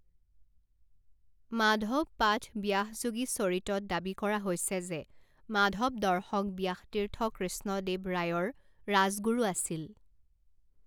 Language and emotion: Assamese, neutral